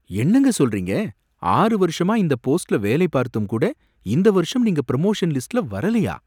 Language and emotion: Tamil, surprised